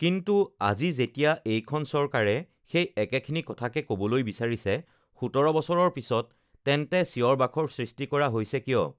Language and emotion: Assamese, neutral